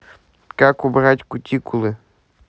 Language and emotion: Russian, neutral